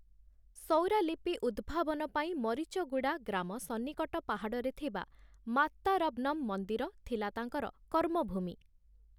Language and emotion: Odia, neutral